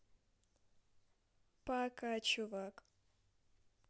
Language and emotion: Russian, neutral